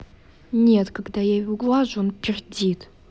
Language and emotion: Russian, angry